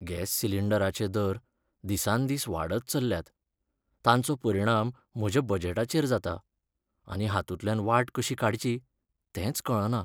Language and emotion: Goan Konkani, sad